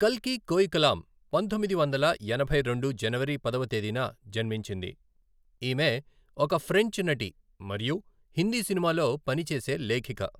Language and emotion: Telugu, neutral